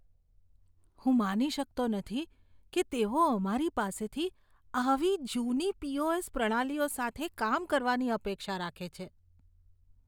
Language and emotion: Gujarati, disgusted